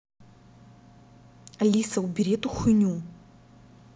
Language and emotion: Russian, angry